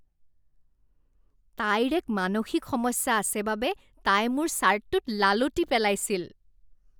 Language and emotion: Assamese, disgusted